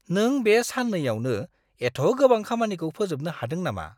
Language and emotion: Bodo, surprised